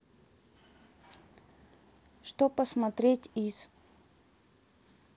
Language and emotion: Russian, neutral